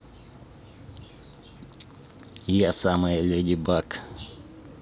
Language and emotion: Russian, neutral